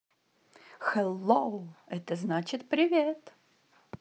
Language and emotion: Russian, positive